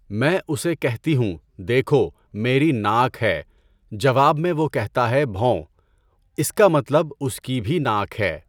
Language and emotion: Urdu, neutral